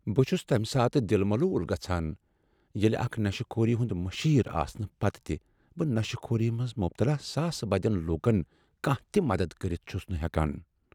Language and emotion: Kashmiri, sad